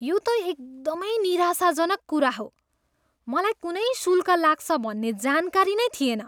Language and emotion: Nepali, disgusted